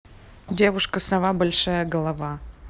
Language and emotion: Russian, neutral